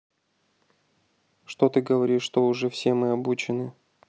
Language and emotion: Russian, neutral